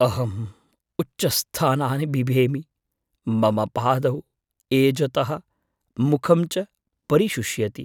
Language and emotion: Sanskrit, fearful